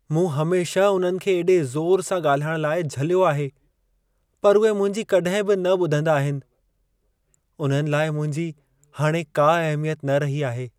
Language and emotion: Sindhi, sad